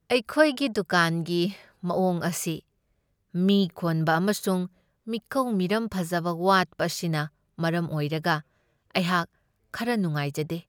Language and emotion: Manipuri, sad